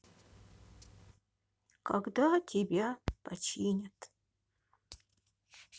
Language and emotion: Russian, sad